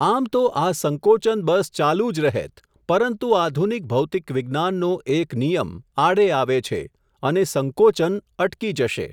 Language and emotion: Gujarati, neutral